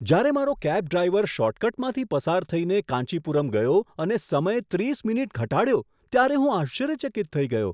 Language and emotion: Gujarati, surprised